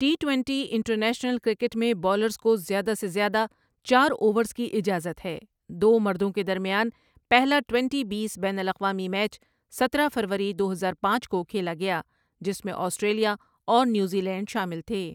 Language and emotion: Urdu, neutral